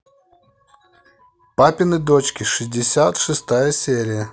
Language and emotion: Russian, neutral